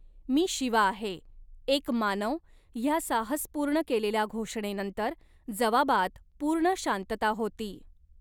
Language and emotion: Marathi, neutral